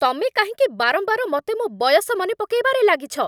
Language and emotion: Odia, angry